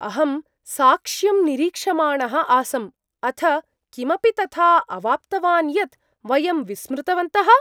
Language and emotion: Sanskrit, surprised